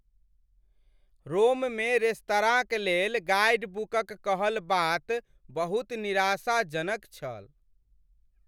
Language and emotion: Maithili, sad